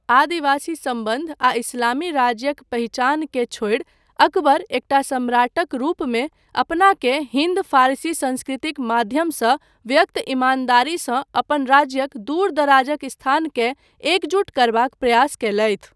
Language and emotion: Maithili, neutral